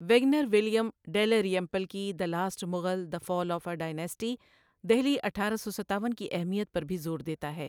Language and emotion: Urdu, neutral